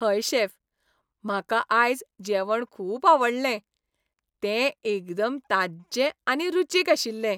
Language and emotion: Goan Konkani, happy